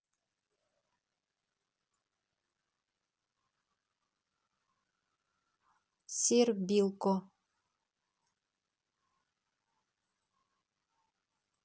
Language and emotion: Russian, neutral